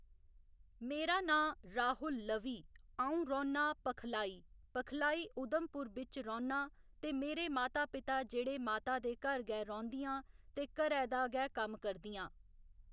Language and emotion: Dogri, neutral